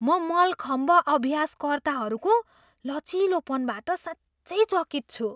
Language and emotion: Nepali, surprised